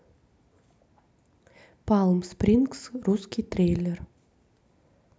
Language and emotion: Russian, neutral